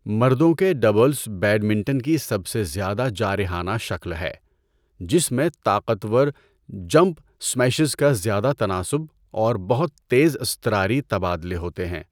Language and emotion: Urdu, neutral